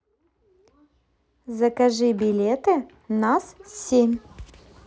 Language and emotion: Russian, positive